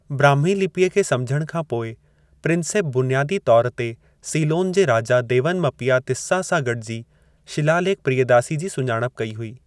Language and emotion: Sindhi, neutral